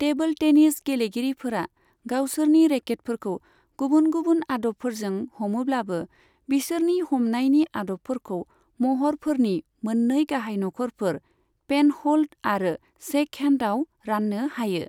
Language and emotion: Bodo, neutral